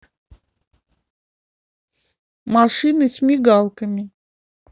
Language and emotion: Russian, neutral